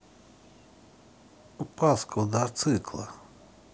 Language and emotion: Russian, neutral